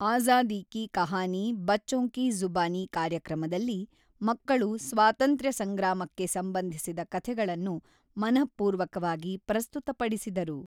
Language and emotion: Kannada, neutral